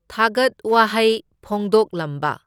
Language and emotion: Manipuri, neutral